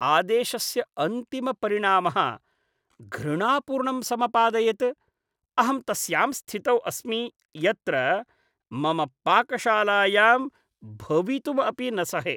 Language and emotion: Sanskrit, disgusted